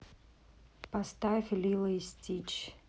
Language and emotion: Russian, neutral